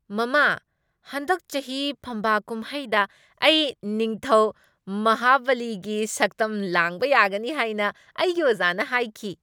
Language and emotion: Manipuri, happy